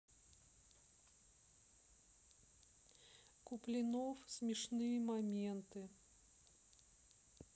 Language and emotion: Russian, neutral